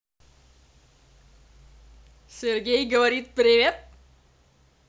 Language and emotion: Russian, positive